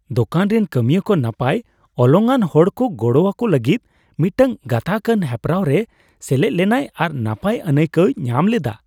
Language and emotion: Santali, happy